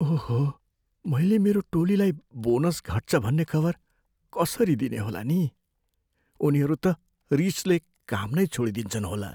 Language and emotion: Nepali, fearful